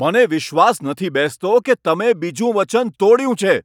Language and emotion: Gujarati, angry